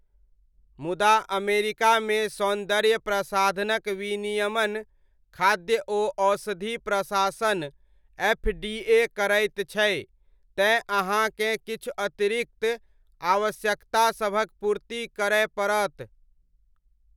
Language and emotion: Maithili, neutral